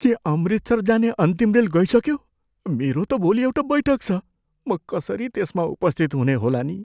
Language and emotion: Nepali, fearful